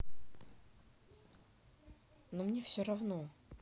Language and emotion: Russian, neutral